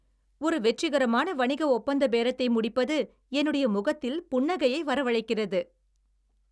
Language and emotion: Tamil, happy